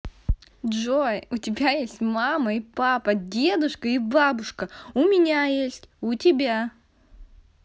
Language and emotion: Russian, positive